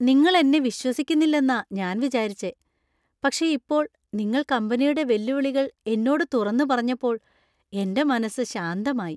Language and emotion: Malayalam, happy